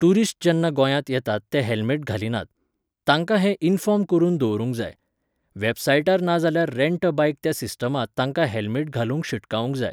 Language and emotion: Goan Konkani, neutral